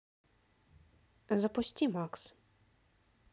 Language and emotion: Russian, neutral